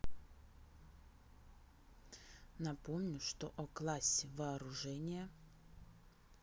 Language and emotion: Russian, neutral